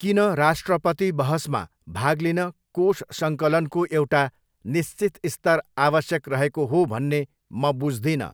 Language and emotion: Nepali, neutral